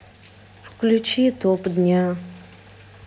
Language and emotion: Russian, sad